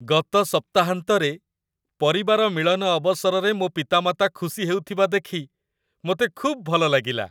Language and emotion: Odia, happy